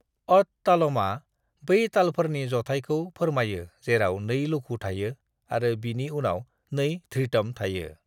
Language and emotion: Bodo, neutral